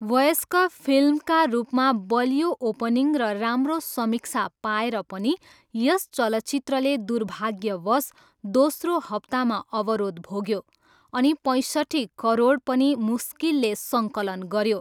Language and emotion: Nepali, neutral